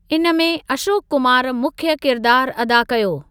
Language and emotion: Sindhi, neutral